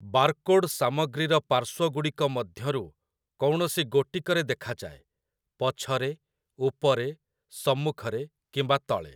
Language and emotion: Odia, neutral